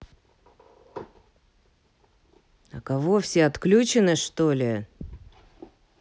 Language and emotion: Russian, angry